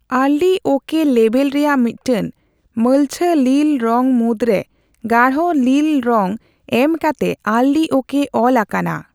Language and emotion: Santali, neutral